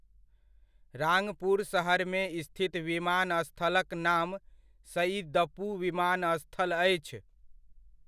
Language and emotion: Maithili, neutral